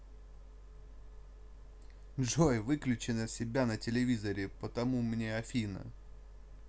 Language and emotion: Russian, neutral